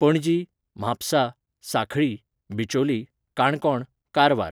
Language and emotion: Goan Konkani, neutral